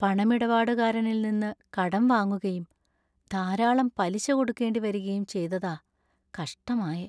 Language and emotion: Malayalam, sad